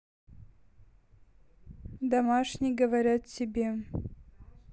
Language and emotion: Russian, neutral